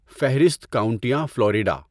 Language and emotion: Urdu, neutral